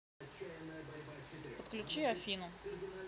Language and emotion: Russian, neutral